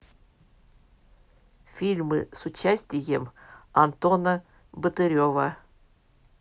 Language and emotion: Russian, neutral